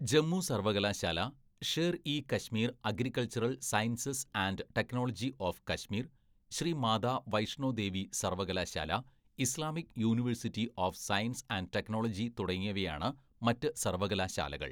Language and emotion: Malayalam, neutral